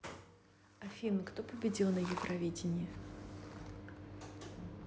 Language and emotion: Russian, neutral